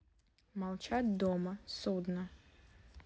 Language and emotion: Russian, neutral